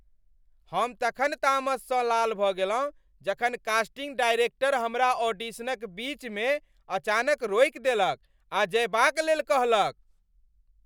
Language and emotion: Maithili, angry